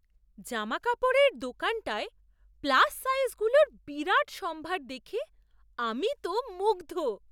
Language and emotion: Bengali, surprised